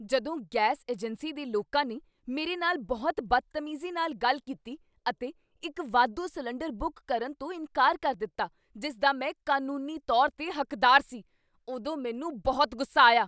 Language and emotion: Punjabi, angry